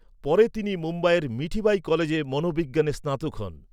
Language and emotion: Bengali, neutral